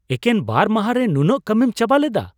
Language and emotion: Santali, surprised